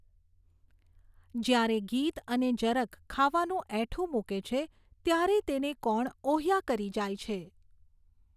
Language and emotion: Gujarati, neutral